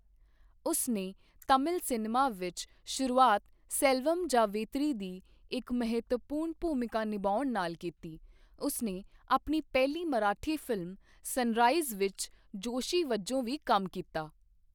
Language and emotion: Punjabi, neutral